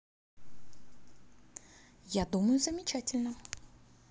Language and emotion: Russian, positive